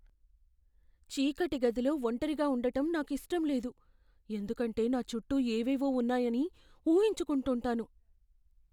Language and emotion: Telugu, fearful